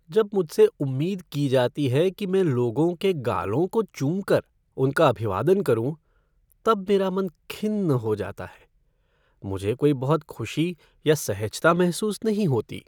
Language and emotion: Hindi, sad